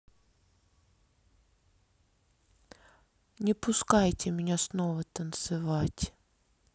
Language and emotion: Russian, sad